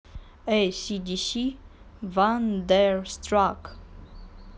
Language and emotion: Russian, neutral